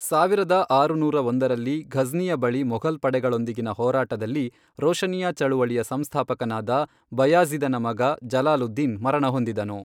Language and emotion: Kannada, neutral